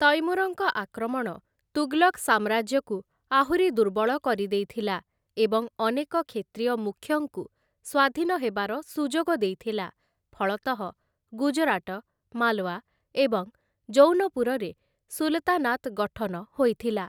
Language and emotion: Odia, neutral